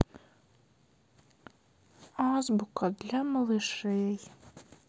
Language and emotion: Russian, sad